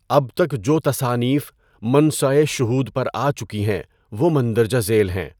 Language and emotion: Urdu, neutral